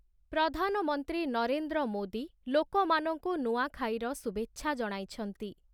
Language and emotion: Odia, neutral